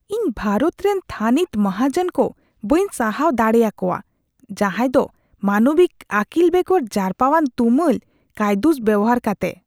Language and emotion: Santali, disgusted